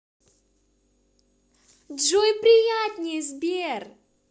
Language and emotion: Russian, positive